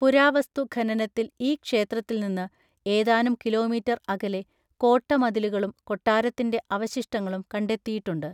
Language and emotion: Malayalam, neutral